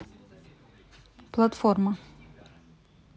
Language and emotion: Russian, neutral